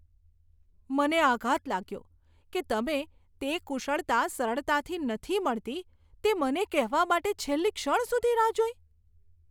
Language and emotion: Gujarati, disgusted